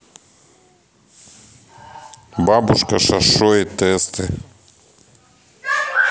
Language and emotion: Russian, neutral